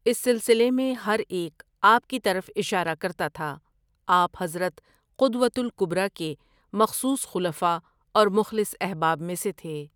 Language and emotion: Urdu, neutral